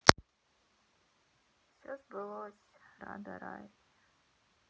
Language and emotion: Russian, sad